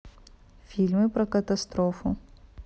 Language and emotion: Russian, neutral